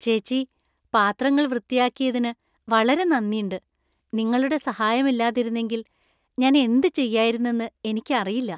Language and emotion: Malayalam, happy